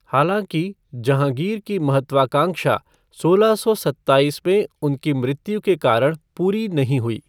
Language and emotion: Hindi, neutral